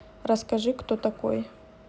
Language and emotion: Russian, neutral